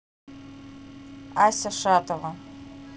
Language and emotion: Russian, neutral